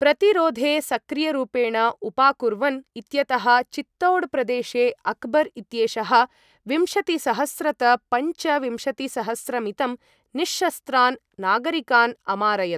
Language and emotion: Sanskrit, neutral